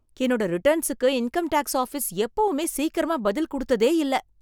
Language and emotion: Tamil, surprised